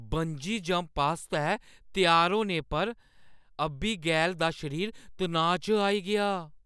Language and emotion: Dogri, fearful